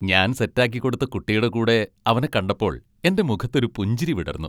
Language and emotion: Malayalam, happy